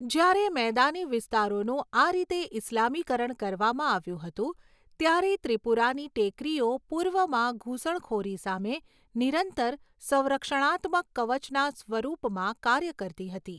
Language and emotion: Gujarati, neutral